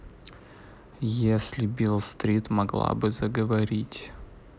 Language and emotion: Russian, neutral